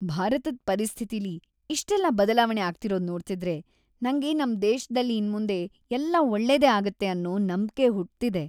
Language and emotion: Kannada, happy